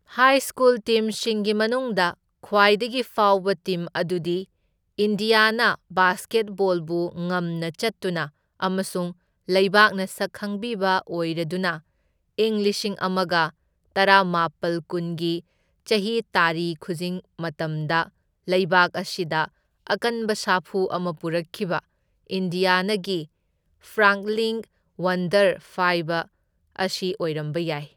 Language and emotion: Manipuri, neutral